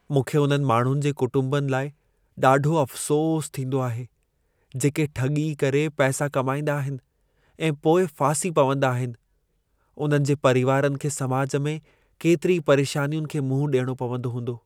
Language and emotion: Sindhi, sad